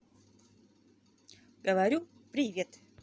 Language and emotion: Russian, positive